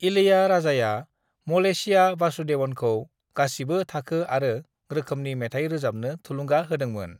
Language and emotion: Bodo, neutral